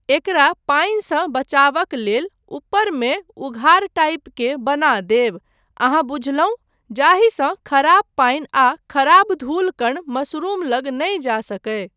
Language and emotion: Maithili, neutral